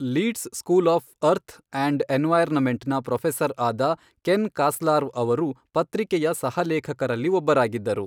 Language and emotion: Kannada, neutral